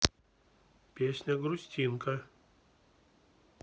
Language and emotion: Russian, neutral